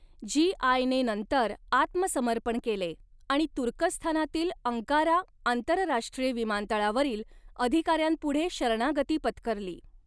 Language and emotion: Marathi, neutral